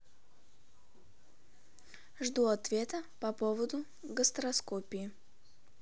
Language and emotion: Russian, neutral